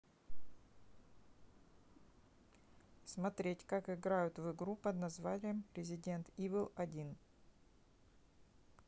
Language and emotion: Russian, neutral